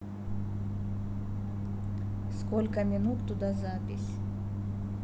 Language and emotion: Russian, neutral